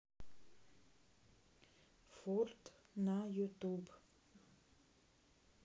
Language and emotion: Russian, neutral